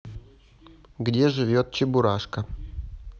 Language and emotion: Russian, neutral